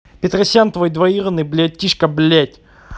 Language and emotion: Russian, angry